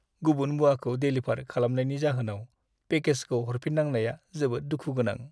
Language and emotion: Bodo, sad